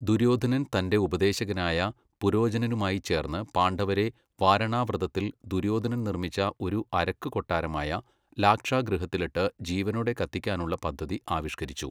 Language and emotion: Malayalam, neutral